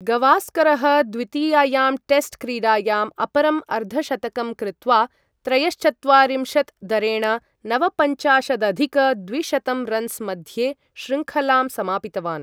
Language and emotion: Sanskrit, neutral